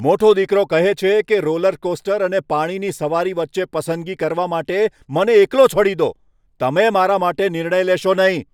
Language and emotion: Gujarati, angry